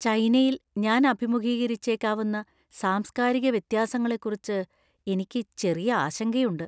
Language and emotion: Malayalam, fearful